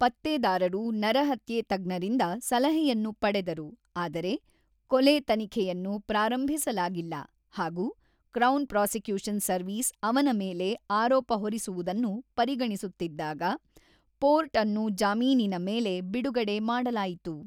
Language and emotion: Kannada, neutral